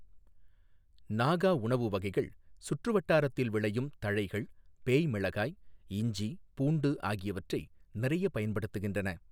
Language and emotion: Tamil, neutral